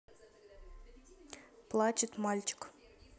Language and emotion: Russian, neutral